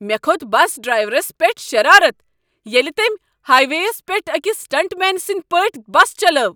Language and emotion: Kashmiri, angry